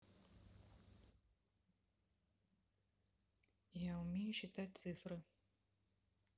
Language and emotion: Russian, neutral